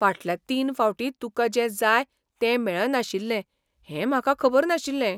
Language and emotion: Goan Konkani, surprised